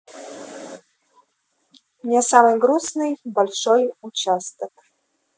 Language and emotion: Russian, neutral